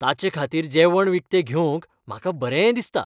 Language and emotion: Goan Konkani, happy